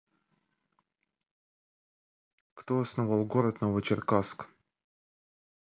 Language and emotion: Russian, neutral